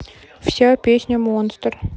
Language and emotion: Russian, neutral